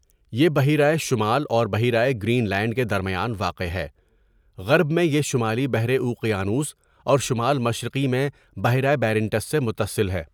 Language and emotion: Urdu, neutral